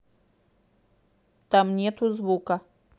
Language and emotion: Russian, neutral